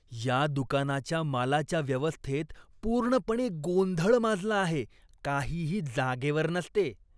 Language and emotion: Marathi, disgusted